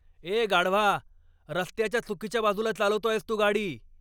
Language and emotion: Marathi, angry